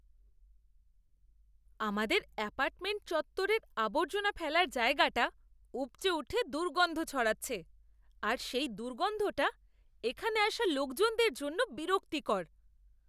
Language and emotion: Bengali, disgusted